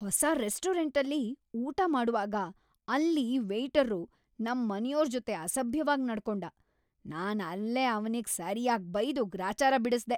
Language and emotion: Kannada, angry